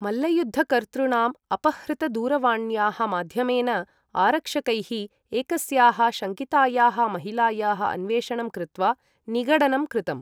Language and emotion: Sanskrit, neutral